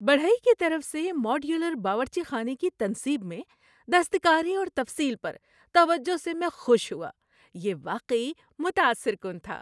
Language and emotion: Urdu, happy